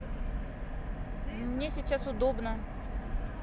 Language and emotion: Russian, neutral